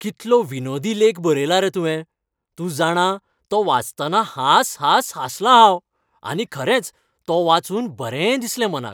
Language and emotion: Goan Konkani, happy